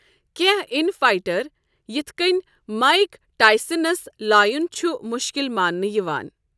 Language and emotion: Kashmiri, neutral